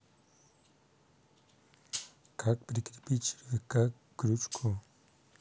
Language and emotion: Russian, neutral